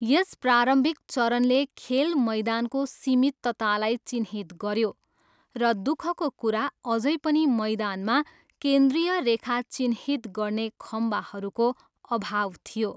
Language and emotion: Nepali, neutral